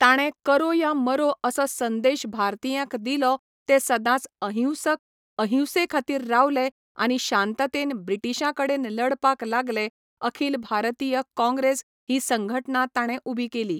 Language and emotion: Goan Konkani, neutral